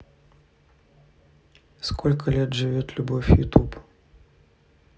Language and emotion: Russian, neutral